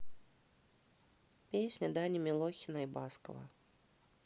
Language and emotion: Russian, neutral